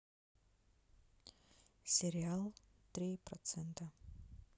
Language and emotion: Russian, neutral